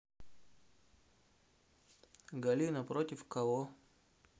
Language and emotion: Russian, neutral